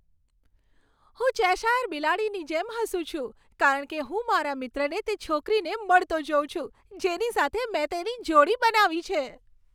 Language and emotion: Gujarati, happy